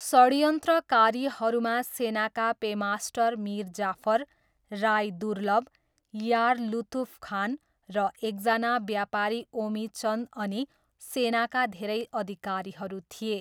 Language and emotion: Nepali, neutral